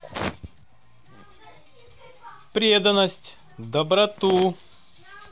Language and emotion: Russian, positive